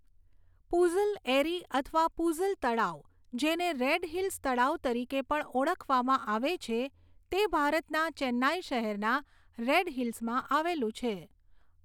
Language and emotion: Gujarati, neutral